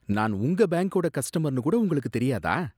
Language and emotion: Tamil, disgusted